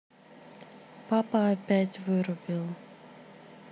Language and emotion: Russian, sad